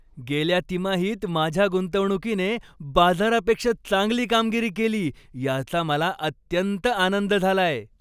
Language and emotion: Marathi, happy